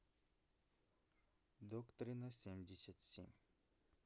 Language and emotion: Russian, neutral